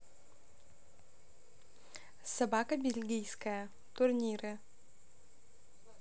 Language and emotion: Russian, neutral